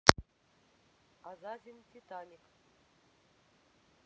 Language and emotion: Russian, neutral